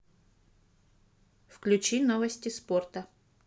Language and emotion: Russian, neutral